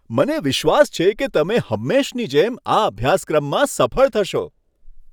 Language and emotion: Gujarati, happy